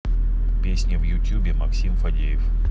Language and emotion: Russian, neutral